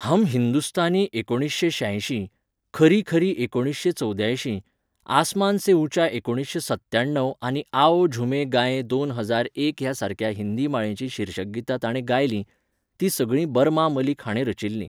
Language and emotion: Goan Konkani, neutral